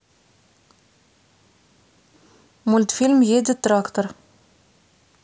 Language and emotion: Russian, neutral